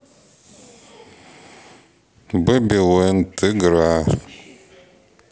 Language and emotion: Russian, neutral